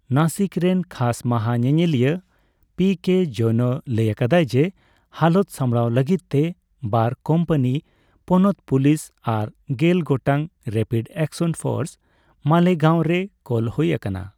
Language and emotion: Santali, neutral